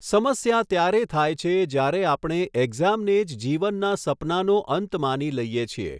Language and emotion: Gujarati, neutral